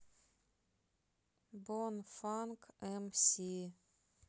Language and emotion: Russian, neutral